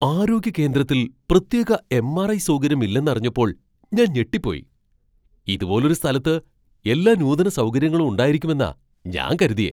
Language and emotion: Malayalam, surprised